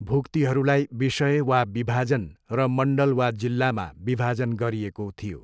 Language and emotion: Nepali, neutral